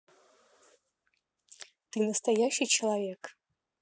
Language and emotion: Russian, neutral